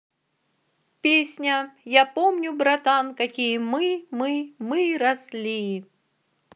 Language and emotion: Russian, positive